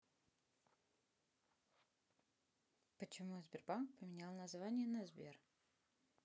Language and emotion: Russian, neutral